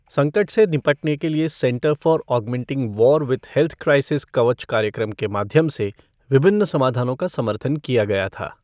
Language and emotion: Hindi, neutral